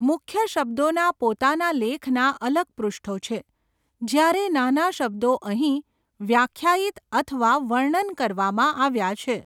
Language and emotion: Gujarati, neutral